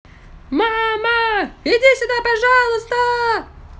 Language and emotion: Russian, positive